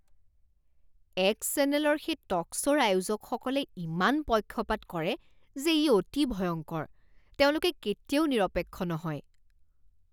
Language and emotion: Assamese, disgusted